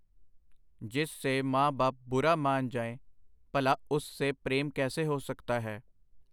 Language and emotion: Punjabi, neutral